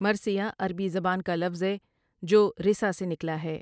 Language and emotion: Urdu, neutral